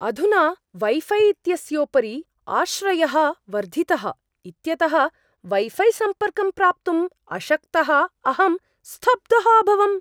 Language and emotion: Sanskrit, surprised